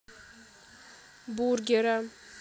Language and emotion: Russian, neutral